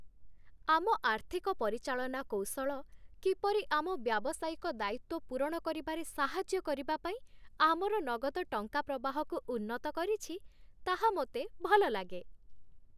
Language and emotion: Odia, happy